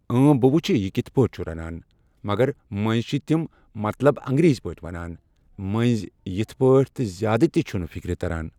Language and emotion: Kashmiri, neutral